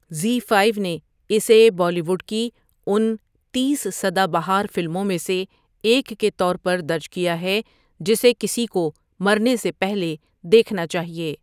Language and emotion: Urdu, neutral